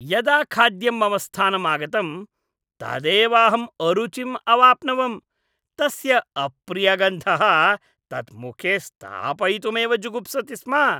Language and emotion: Sanskrit, disgusted